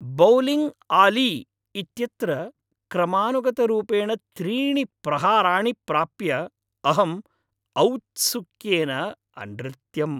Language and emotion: Sanskrit, happy